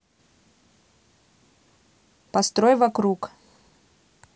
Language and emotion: Russian, neutral